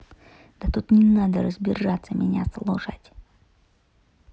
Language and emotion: Russian, angry